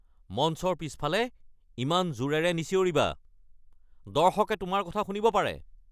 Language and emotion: Assamese, angry